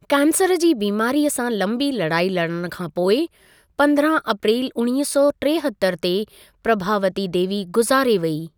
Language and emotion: Sindhi, neutral